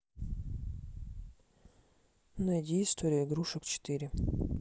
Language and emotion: Russian, neutral